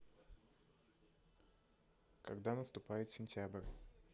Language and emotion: Russian, neutral